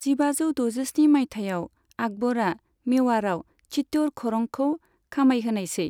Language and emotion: Bodo, neutral